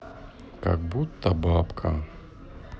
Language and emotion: Russian, sad